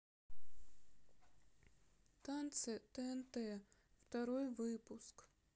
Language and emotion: Russian, sad